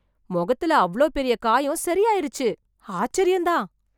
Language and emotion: Tamil, surprised